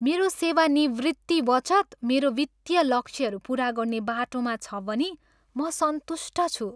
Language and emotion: Nepali, happy